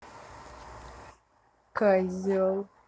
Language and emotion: Russian, angry